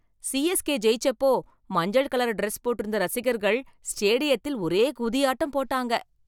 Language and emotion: Tamil, happy